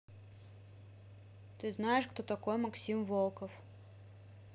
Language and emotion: Russian, neutral